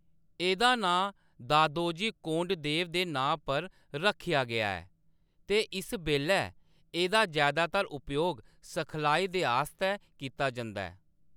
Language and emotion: Dogri, neutral